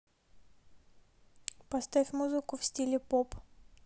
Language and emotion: Russian, neutral